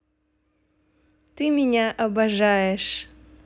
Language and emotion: Russian, positive